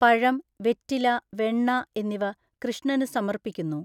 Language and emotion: Malayalam, neutral